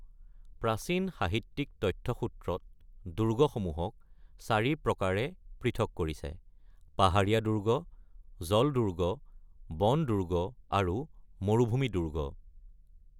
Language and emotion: Assamese, neutral